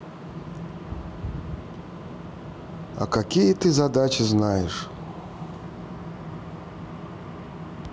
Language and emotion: Russian, neutral